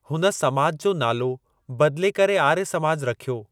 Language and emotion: Sindhi, neutral